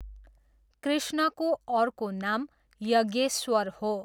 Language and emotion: Nepali, neutral